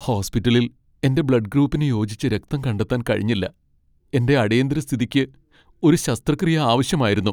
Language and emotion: Malayalam, sad